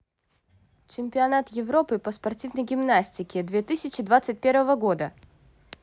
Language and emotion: Russian, neutral